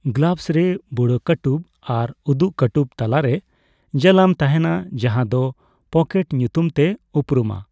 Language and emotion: Santali, neutral